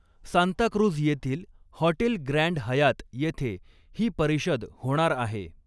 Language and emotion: Marathi, neutral